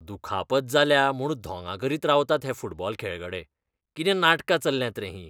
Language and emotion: Goan Konkani, disgusted